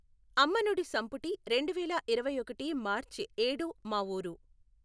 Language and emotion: Telugu, neutral